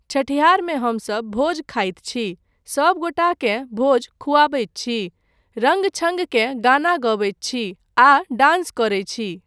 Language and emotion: Maithili, neutral